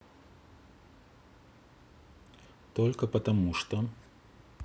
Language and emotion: Russian, neutral